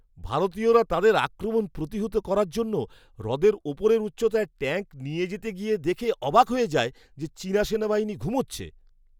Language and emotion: Bengali, surprised